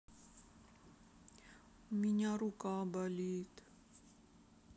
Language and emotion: Russian, sad